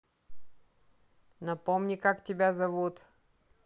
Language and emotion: Russian, neutral